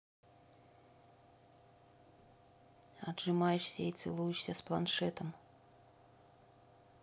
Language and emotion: Russian, neutral